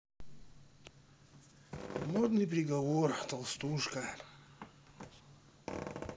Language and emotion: Russian, sad